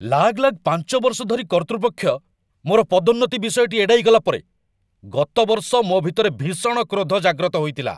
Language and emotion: Odia, angry